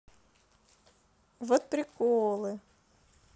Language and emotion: Russian, neutral